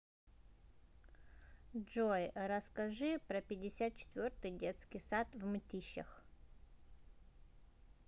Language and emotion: Russian, neutral